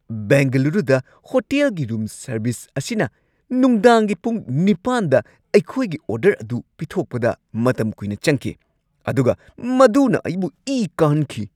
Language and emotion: Manipuri, angry